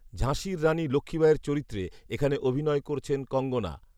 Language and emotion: Bengali, neutral